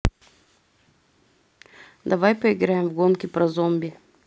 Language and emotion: Russian, neutral